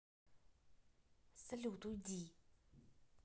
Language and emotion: Russian, angry